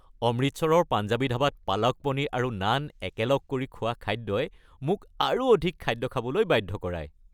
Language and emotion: Assamese, happy